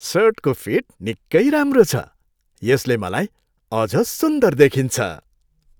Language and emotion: Nepali, happy